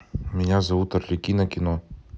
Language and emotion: Russian, neutral